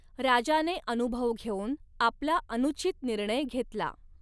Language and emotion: Marathi, neutral